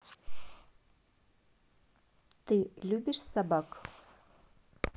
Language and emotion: Russian, neutral